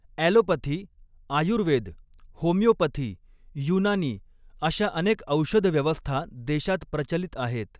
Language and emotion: Marathi, neutral